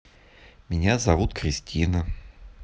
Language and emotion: Russian, neutral